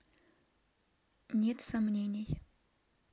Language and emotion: Russian, neutral